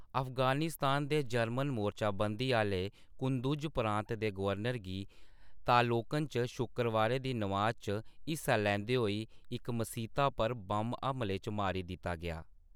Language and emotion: Dogri, neutral